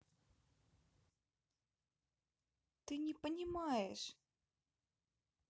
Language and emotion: Russian, neutral